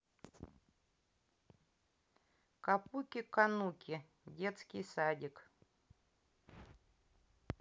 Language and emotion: Russian, neutral